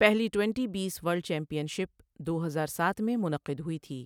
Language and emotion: Urdu, neutral